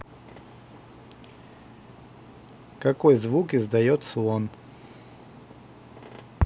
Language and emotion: Russian, neutral